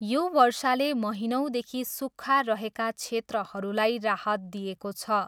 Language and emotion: Nepali, neutral